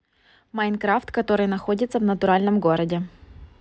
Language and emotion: Russian, neutral